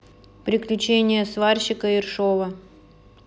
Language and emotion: Russian, neutral